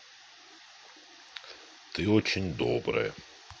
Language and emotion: Russian, neutral